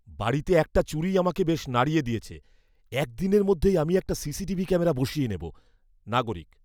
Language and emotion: Bengali, fearful